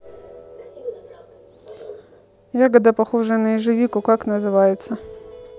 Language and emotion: Russian, neutral